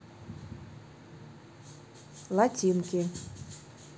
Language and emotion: Russian, neutral